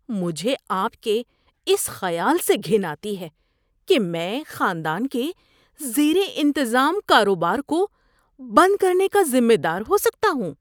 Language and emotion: Urdu, disgusted